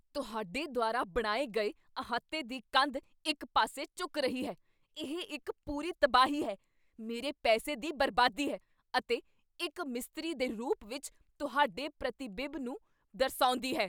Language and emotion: Punjabi, angry